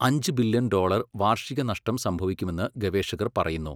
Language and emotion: Malayalam, neutral